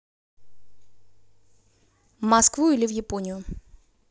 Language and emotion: Russian, neutral